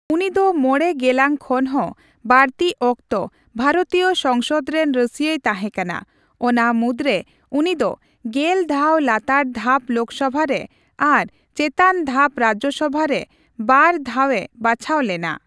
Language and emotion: Santali, neutral